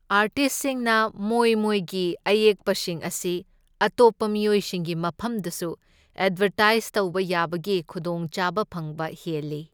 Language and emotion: Manipuri, neutral